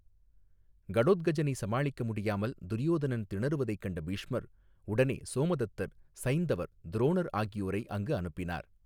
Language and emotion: Tamil, neutral